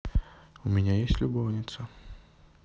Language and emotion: Russian, neutral